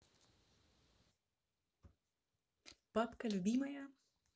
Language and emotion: Russian, positive